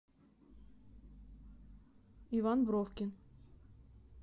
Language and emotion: Russian, neutral